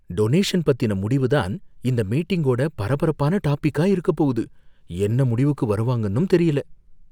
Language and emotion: Tamil, fearful